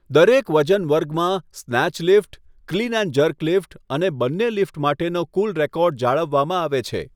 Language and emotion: Gujarati, neutral